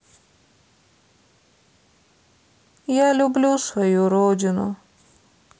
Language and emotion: Russian, sad